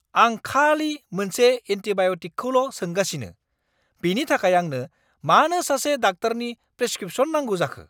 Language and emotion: Bodo, angry